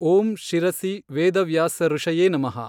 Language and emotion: Kannada, neutral